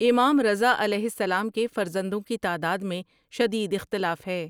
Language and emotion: Urdu, neutral